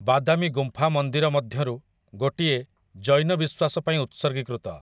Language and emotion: Odia, neutral